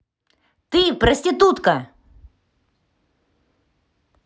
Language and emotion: Russian, angry